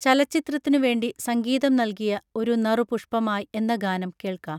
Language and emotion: Malayalam, neutral